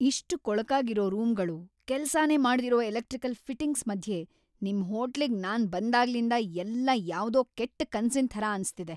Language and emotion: Kannada, angry